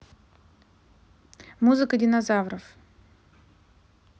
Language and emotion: Russian, neutral